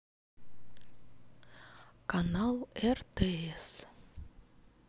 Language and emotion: Russian, neutral